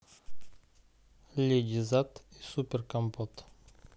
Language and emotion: Russian, neutral